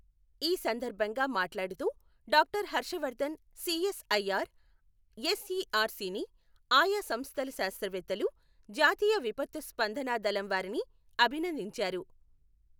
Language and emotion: Telugu, neutral